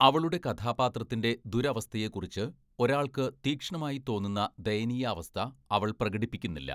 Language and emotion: Malayalam, neutral